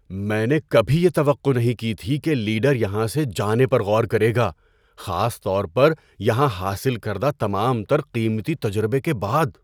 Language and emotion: Urdu, surprised